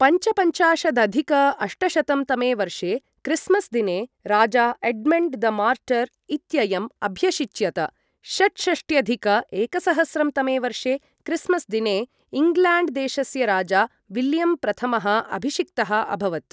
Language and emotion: Sanskrit, neutral